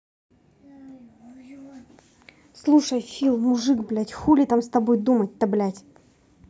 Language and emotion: Russian, angry